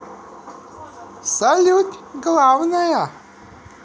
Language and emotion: Russian, positive